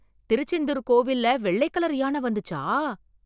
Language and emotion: Tamil, surprised